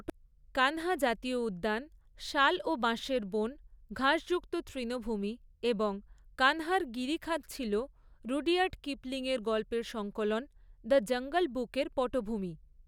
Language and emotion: Bengali, neutral